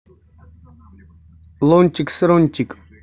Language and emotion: Russian, neutral